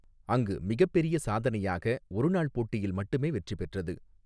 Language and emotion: Tamil, neutral